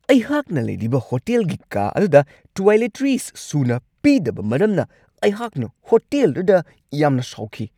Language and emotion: Manipuri, angry